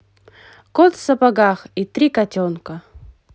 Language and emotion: Russian, positive